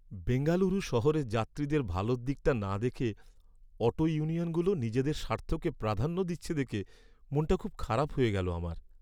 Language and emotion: Bengali, sad